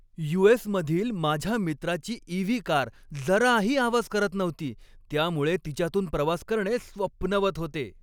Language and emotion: Marathi, happy